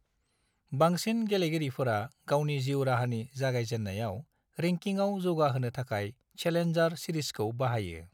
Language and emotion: Bodo, neutral